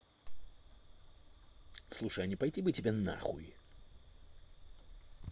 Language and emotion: Russian, angry